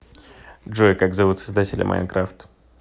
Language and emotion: Russian, neutral